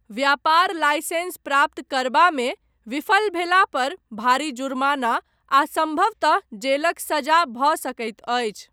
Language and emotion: Maithili, neutral